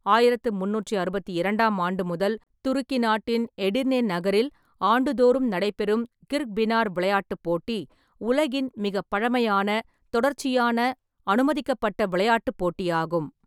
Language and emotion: Tamil, neutral